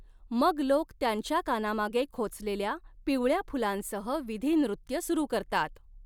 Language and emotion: Marathi, neutral